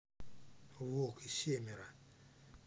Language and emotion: Russian, neutral